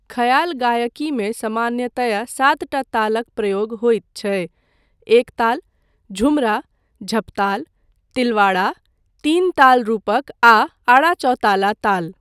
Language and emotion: Maithili, neutral